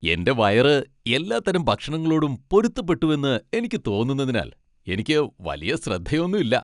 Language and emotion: Malayalam, happy